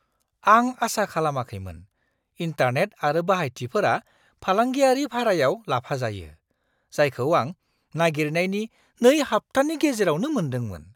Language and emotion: Bodo, surprised